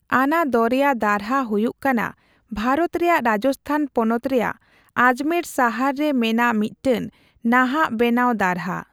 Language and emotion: Santali, neutral